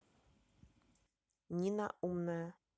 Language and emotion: Russian, neutral